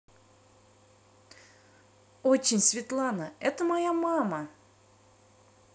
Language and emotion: Russian, positive